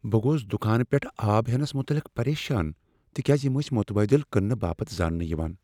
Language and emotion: Kashmiri, fearful